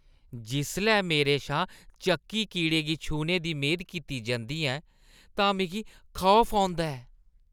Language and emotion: Dogri, disgusted